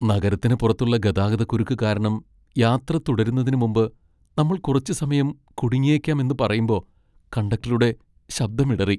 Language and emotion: Malayalam, sad